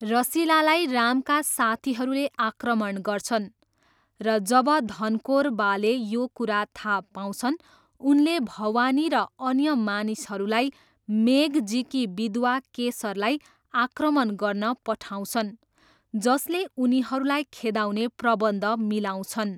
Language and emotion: Nepali, neutral